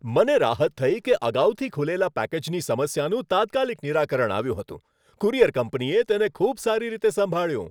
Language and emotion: Gujarati, happy